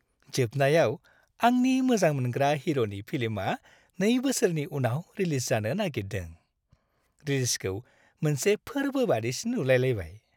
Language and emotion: Bodo, happy